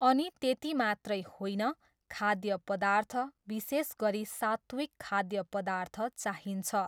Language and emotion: Nepali, neutral